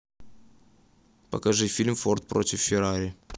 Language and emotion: Russian, neutral